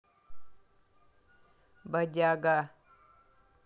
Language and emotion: Russian, neutral